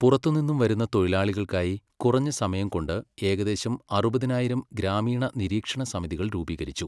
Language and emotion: Malayalam, neutral